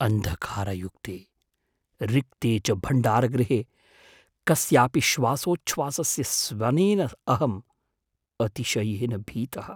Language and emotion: Sanskrit, fearful